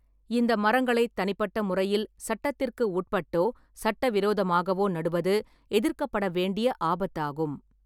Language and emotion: Tamil, neutral